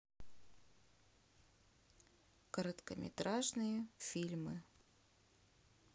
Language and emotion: Russian, neutral